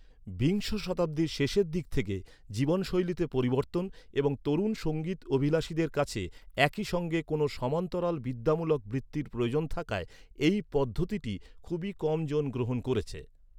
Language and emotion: Bengali, neutral